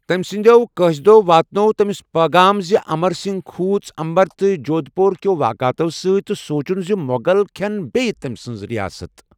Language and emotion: Kashmiri, neutral